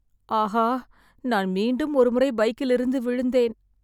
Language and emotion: Tamil, sad